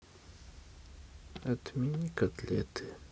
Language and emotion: Russian, sad